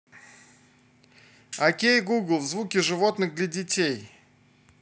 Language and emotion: Russian, positive